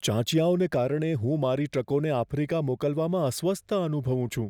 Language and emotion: Gujarati, fearful